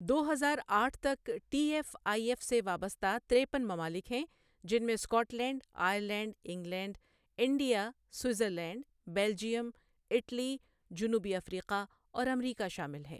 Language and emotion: Urdu, neutral